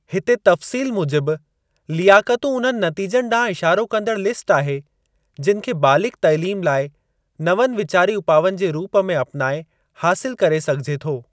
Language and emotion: Sindhi, neutral